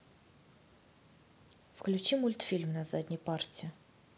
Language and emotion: Russian, neutral